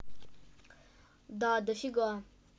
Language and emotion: Russian, neutral